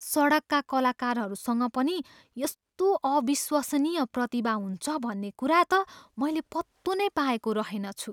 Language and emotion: Nepali, surprised